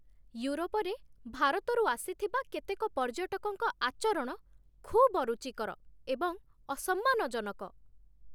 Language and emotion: Odia, disgusted